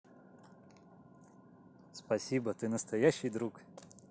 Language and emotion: Russian, positive